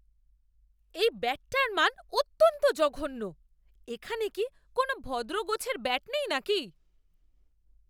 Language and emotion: Bengali, angry